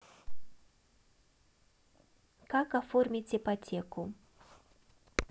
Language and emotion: Russian, neutral